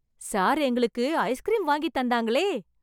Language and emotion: Tamil, happy